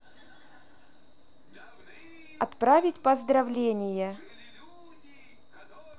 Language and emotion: Russian, neutral